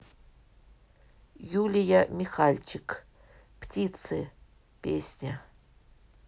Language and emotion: Russian, neutral